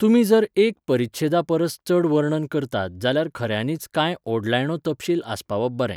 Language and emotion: Goan Konkani, neutral